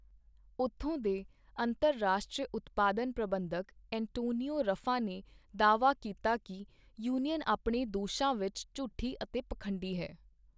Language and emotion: Punjabi, neutral